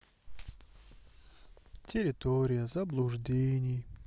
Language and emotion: Russian, sad